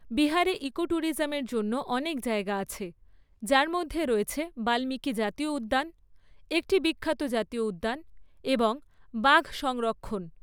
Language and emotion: Bengali, neutral